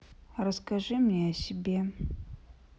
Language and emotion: Russian, sad